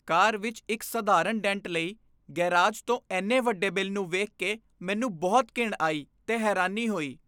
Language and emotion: Punjabi, disgusted